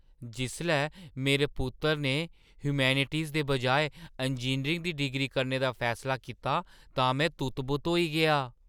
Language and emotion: Dogri, surprised